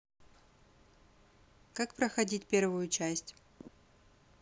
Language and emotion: Russian, neutral